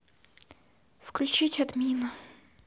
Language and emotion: Russian, neutral